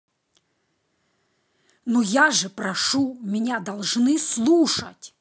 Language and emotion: Russian, angry